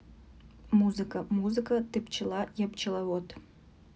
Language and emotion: Russian, neutral